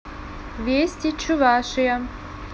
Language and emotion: Russian, neutral